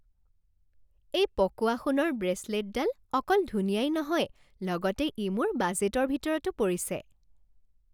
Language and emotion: Assamese, happy